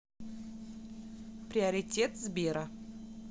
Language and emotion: Russian, neutral